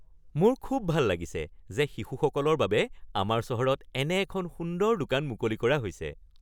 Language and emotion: Assamese, happy